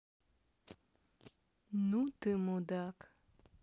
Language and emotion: Russian, neutral